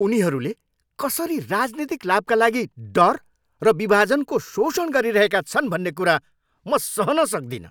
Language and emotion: Nepali, angry